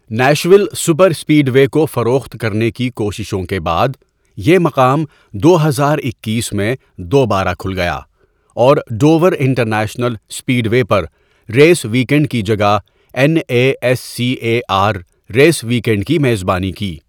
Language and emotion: Urdu, neutral